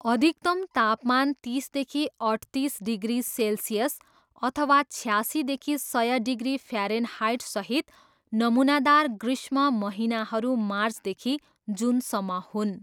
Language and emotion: Nepali, neutral